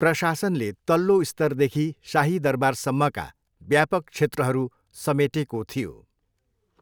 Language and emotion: Nepali, neutral